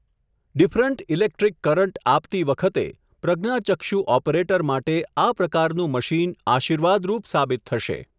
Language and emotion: Gujarati, neutral